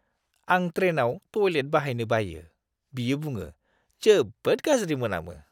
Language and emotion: Bodo, disgusted